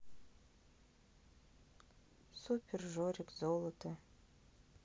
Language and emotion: Russian, sad